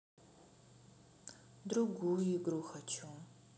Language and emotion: Russian, sad